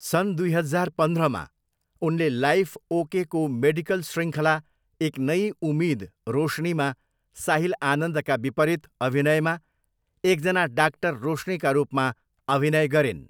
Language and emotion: Nepali, neutral